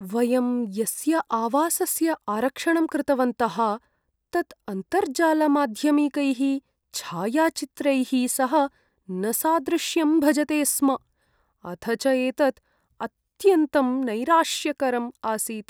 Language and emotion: Sanskrit, sad